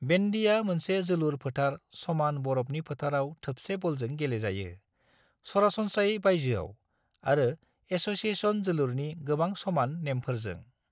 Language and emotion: Bodo, neutral